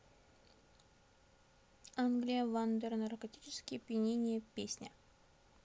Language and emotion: Russian, neutral